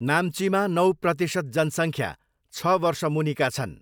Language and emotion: Nepali, neutral